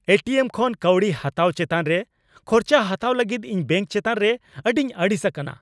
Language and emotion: Santali, angry